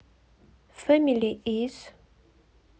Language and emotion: Russian, neutral